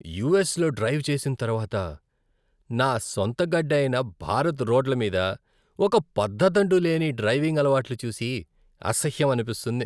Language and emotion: Telugu, disgusted